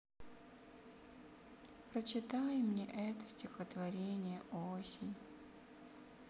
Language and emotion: Russian, sad